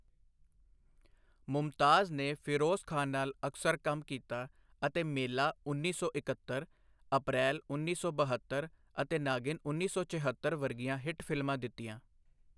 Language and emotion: Punjabi, neutral